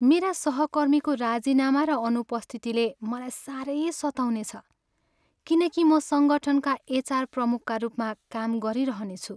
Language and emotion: Nepali, sad